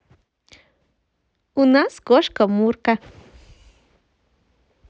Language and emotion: Russian, positive